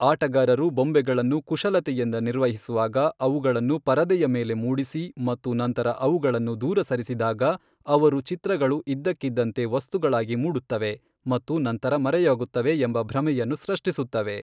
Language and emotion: Kannada, neutral